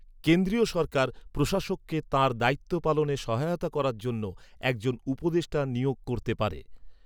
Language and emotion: Bengali, neutral